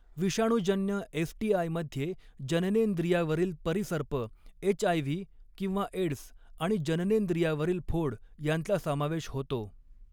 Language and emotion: Marathi, neutral